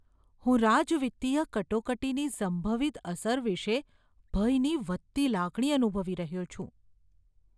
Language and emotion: Gujarati, fearful